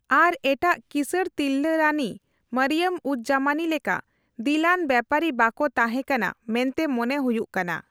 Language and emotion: Santali, neutral